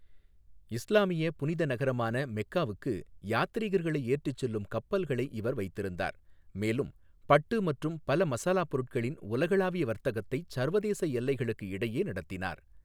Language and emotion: Tamil, neutral